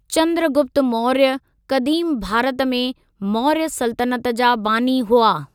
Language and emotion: Sindhi, neutral